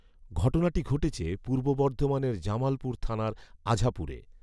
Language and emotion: Bengali, neutral